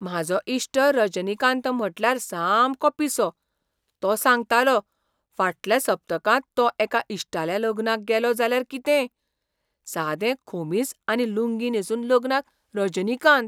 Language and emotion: Goan Konkani, surprised